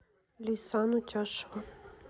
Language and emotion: Russian, neutral